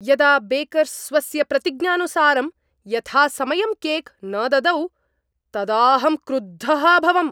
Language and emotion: Sanskrit, angry